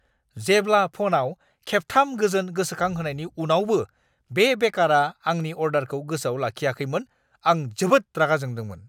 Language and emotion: Bodo, angry